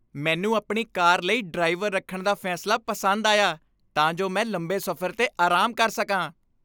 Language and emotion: Punjabi, happy